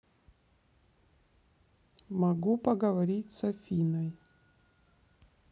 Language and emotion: Russian, neutral